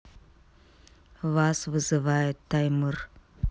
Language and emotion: Russian, neutral